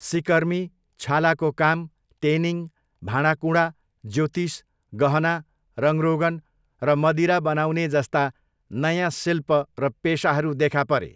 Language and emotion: Nepali, neutral